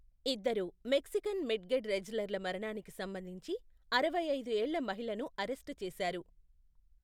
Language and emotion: Telugu, neutral